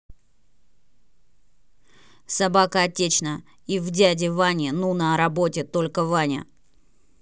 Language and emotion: Russian, angry